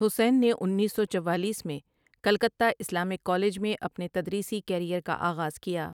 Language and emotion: Urdu, neutral